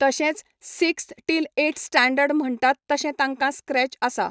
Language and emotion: Goan Konkani, neutral